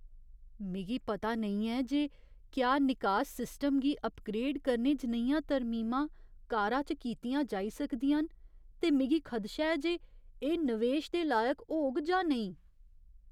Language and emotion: Dogri, fearful